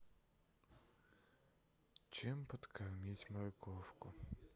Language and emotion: Russian, sad